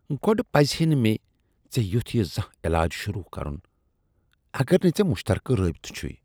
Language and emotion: Kashmiri, disgusted